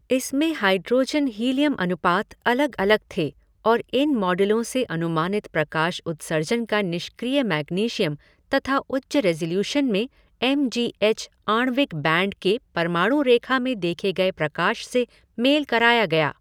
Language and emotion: Hindi, neutral